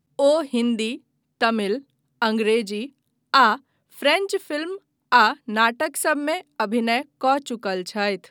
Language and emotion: Maithili, neutral